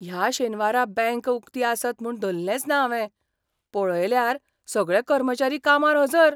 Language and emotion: Goan Konkani, surprised